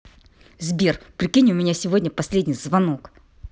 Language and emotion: Russian, angry